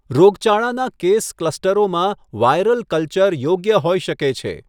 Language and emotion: Gujarati, neutral